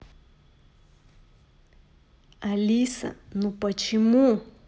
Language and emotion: Russian, angry